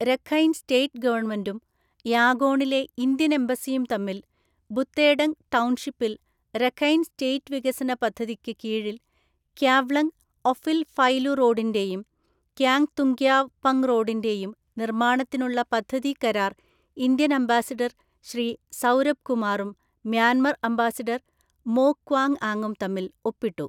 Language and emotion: Malayalam, neutral